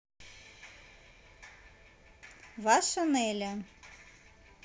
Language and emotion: Russian, neutral